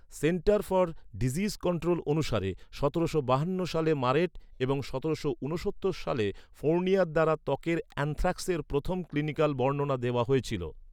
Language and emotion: Bengali, neutral